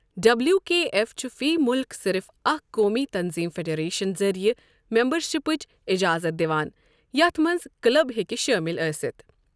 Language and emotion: Kashmiri, neutral